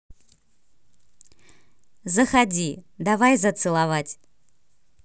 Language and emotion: Russian, positive